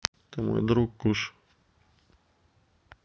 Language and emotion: Russian, neutral